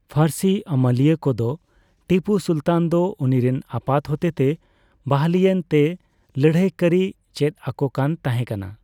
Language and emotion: Santali, neutral